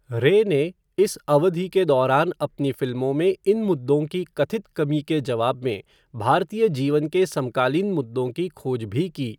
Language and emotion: Hindi, neutral